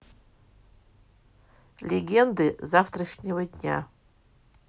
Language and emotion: Russian, neutral